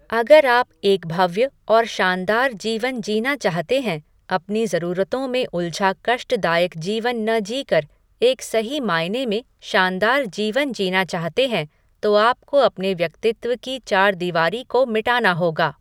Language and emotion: Hindi, neutral